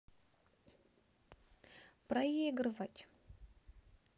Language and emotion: Russian, sad